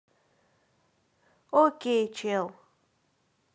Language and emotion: Russian, positive